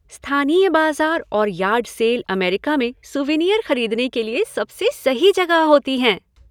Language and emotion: Hindi, happy